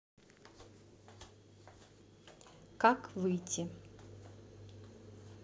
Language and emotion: Russian, neutral